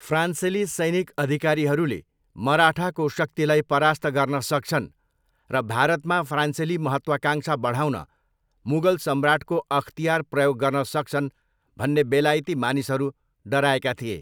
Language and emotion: Nepali, neutral